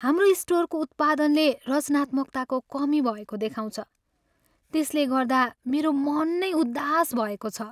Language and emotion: Nepali, sad